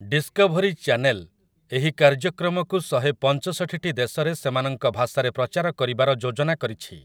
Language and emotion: Odia, neutral